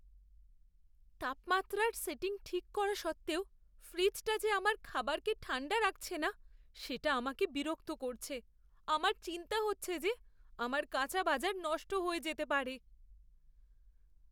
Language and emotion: Bengali, fearful